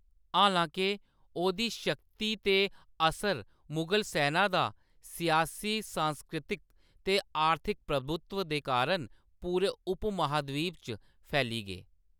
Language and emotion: Dogri, neutral